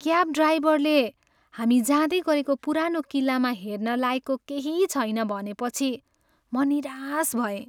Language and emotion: Nepali, sad